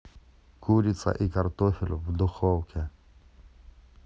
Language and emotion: Russian, neutral